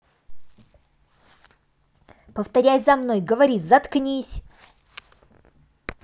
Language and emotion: Russian, angry